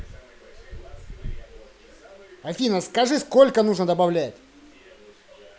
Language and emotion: Russian, angry